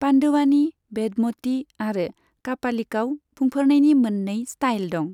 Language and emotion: Bodo, neutral